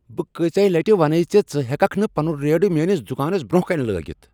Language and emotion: Kashmiri, angry